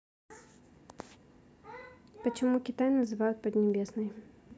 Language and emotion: Russian, neutral